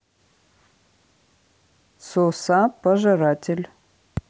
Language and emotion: Russian, neutral